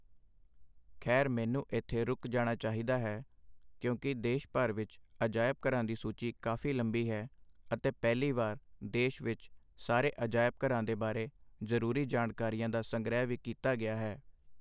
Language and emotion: Punjabi, neutral